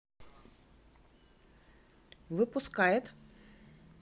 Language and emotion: Russian, neutral